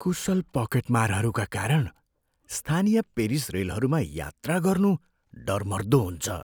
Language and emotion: Nepali, fearful